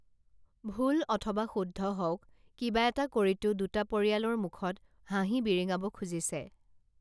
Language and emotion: Assamese, neutral